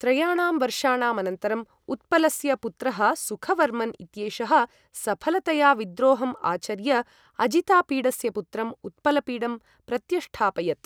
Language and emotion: Sanskrit, neutral